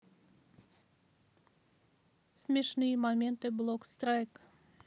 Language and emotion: Russian, neutral